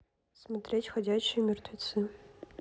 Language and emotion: Russian, neutral